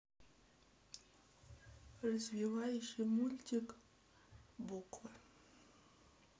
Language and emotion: Russian, neutral